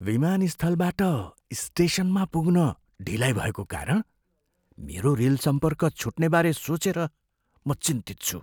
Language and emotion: Nepali, fearful